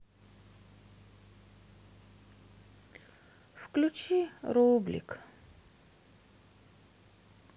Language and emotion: Russian, sad